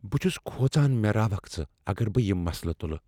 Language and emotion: Kashmiri, fearful